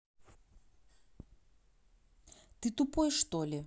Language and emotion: Russian, angry